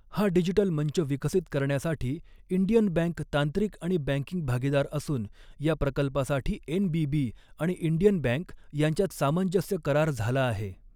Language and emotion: Marathi, neutral